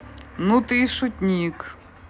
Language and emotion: Russian, neutral